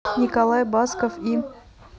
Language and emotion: Russian, neutral